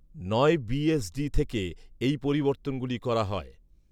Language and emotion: Bengali, neutral